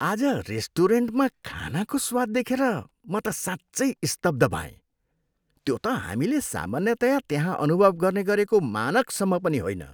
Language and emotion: Nepali, disgusted